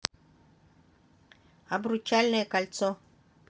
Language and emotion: Russian, positive